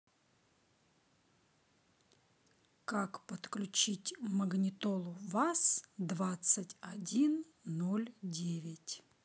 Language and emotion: Russian, neutral